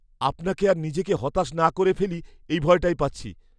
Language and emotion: Bengali, fearful